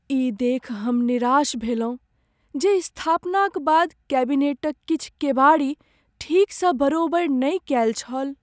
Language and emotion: Maithili, sad